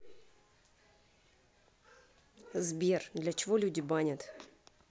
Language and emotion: Russian, neutral